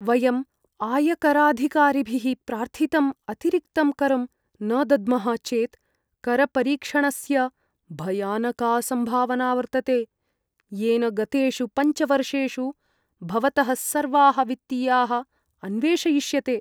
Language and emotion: Sanskrit, fearful